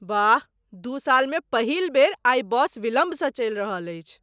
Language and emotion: Maithili, surprised